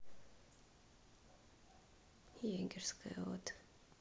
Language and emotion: Russian, sad